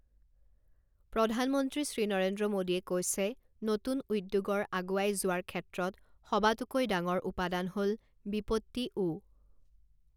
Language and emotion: Assamese, neutral